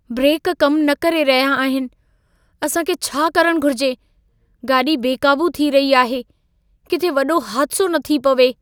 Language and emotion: Sindhi, fearful